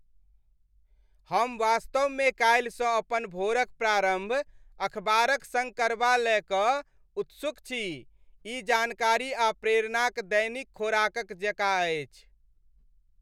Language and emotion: Maithili, happy